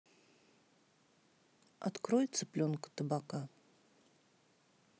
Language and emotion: Russian, neutral